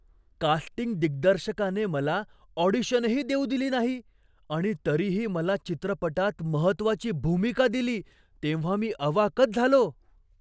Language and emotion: Marathi, surprised